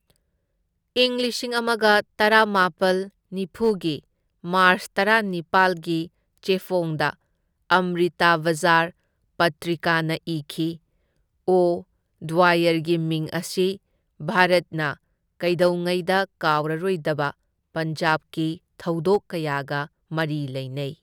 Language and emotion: Manipuri, neutral